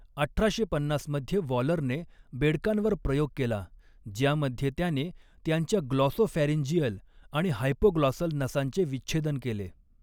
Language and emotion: Marathi, neutral